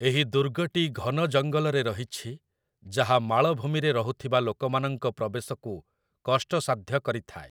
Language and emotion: Odia, neutral